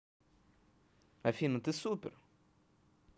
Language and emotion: Russian, positive